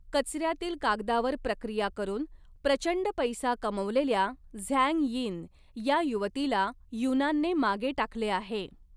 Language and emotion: Marathi, neutral